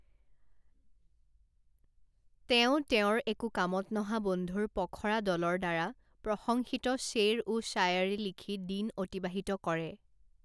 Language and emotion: Assamese, neutral